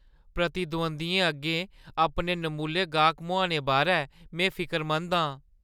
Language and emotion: Dogri, fearful